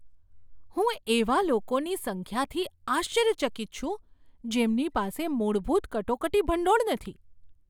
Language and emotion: Gujarati, surprised